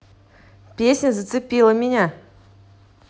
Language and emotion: Russian, positive